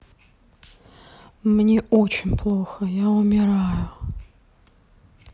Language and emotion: Russian, sad